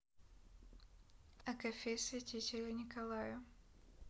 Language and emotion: Russian, neutral